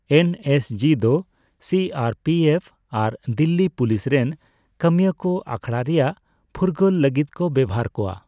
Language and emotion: Santali, neutral